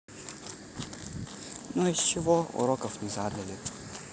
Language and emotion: Russian, neutral